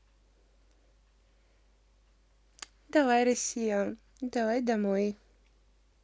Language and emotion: Russian, neutral